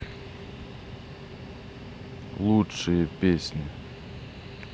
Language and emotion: Russian, neutral